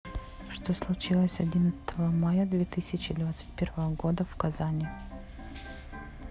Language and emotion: Russian, neutral